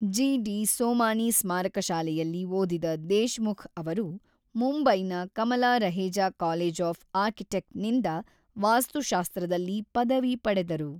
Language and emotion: Kannada, neutral